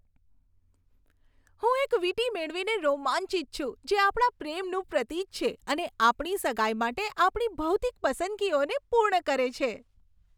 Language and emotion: Gujarati, happy